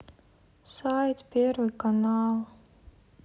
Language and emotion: Russian, sad